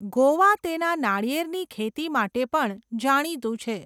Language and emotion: Gujarati, neutral